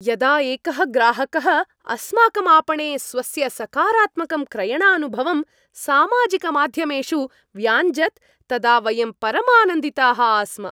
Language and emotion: Sanskrit, happy